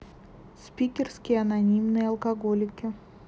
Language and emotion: Russian, neutral